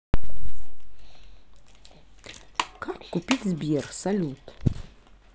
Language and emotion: Russian, neutral